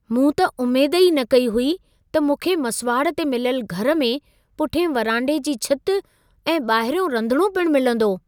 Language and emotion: Sindhi, surprised